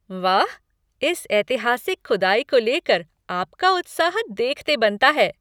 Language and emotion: Hindi, happy